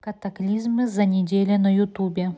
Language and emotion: Russian, neutral